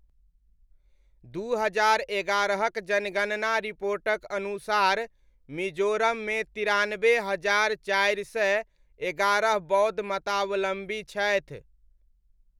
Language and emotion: Maithili, neutral